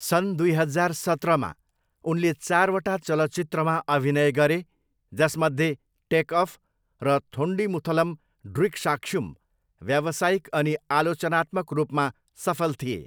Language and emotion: Nepali, neutral